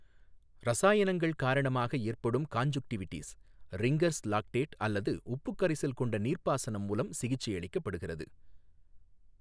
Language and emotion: Tamil, neutral